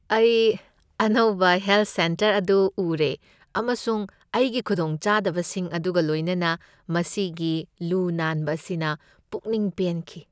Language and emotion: Manipuri, happy